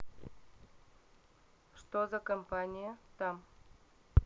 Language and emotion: Russian, neutral